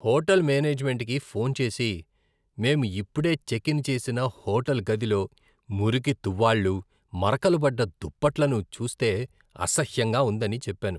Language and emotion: Telugu, disgusted